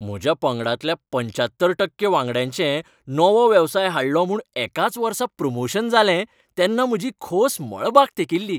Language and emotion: Goan Konkani, happy